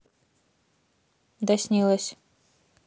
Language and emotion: Russian, neutral